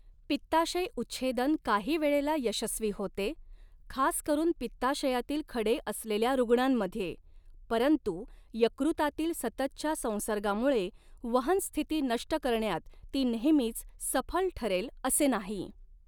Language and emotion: Marathi, neutral